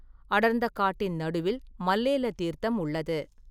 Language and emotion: Tamil, neutral